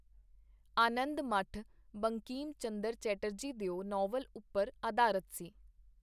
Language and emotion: Punjabi, neutral